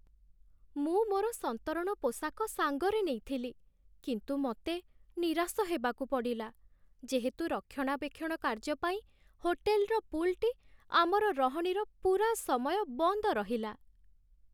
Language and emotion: Odia, sad